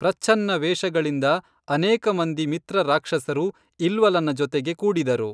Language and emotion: Kannada, neutral